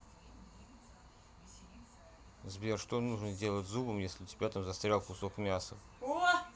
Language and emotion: Russian, neutral